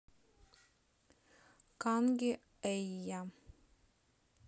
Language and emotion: Russian, neutral